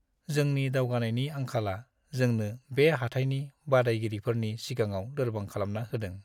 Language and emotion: Bodo, sad